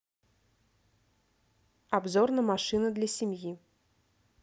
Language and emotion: Russian, neutral